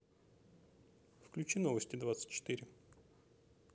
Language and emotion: Russian, neutral